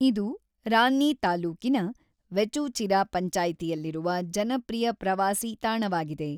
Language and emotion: Kannada, neutral